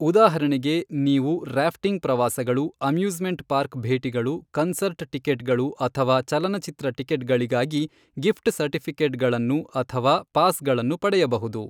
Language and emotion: Kannada, neutral